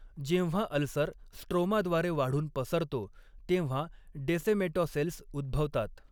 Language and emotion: Marathi, neutral